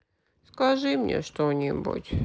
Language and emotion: Russian, sad